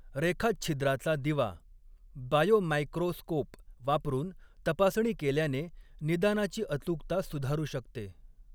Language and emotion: Marathi, neutral